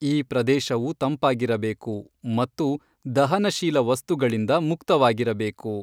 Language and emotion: Kannada, neutral